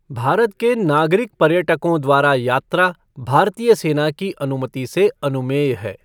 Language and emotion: Hindi, neutral